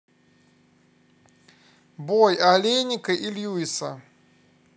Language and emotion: Russian, neutral